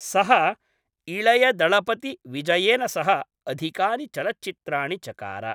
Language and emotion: Sanskrit, neutral